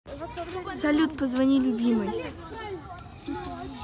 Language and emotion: Russian, neutral